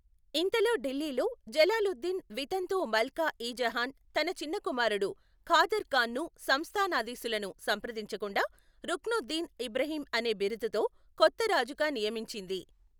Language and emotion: Telugu, neutral